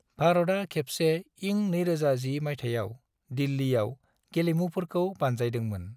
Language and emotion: Bodo, neutral